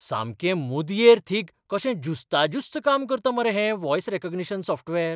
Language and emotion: Goan Konkani, surprised